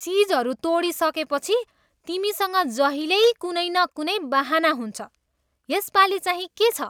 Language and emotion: Nepali, disgusted